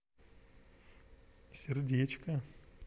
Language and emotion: Russian, positive